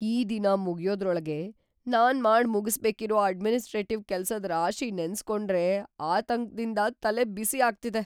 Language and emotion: Kannada, fearful